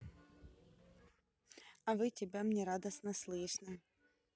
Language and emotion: Russian, positive